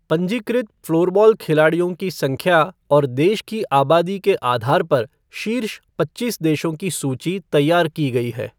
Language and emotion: Hindi, neutral